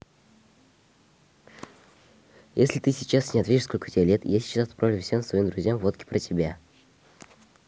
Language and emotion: Russian, neutral